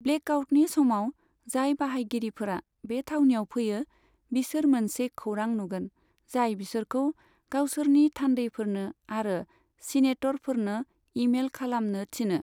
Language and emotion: Bodo, neutral